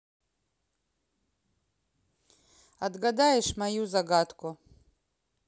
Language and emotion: Russian, neutral